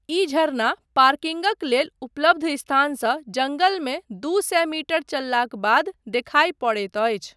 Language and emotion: Maithili, neutral